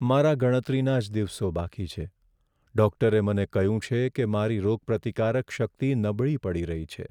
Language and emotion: Gujarati, sad